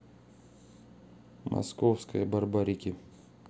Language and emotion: Russian, neutral